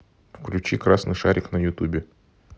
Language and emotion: Russian, neutral